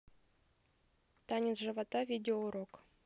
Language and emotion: Russian, neutral